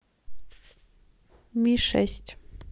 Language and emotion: Russian, neutral